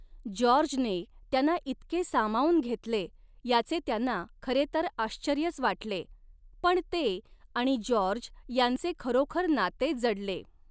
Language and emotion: Marathi, neutral